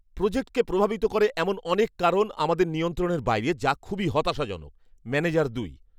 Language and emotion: Bengali, angry